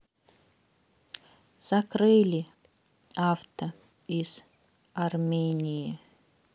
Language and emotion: Russian, sad